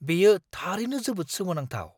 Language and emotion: Bodo, surprised